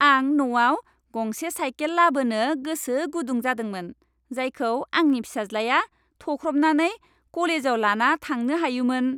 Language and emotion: Bodo, happy